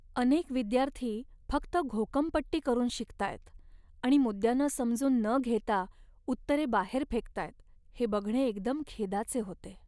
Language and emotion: Marathi, sad